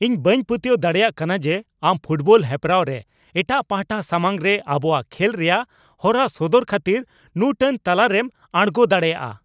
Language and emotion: Santali, angry